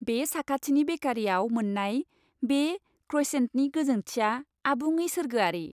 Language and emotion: Bodo, happy